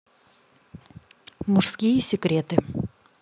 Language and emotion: Russian, neutral